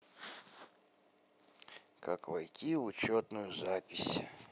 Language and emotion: Russian, sad